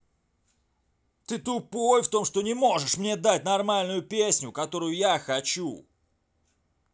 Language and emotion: Russian, angry